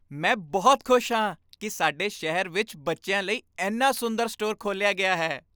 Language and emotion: Punjabi, happy